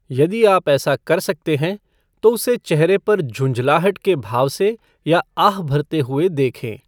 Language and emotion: Hindi, neutral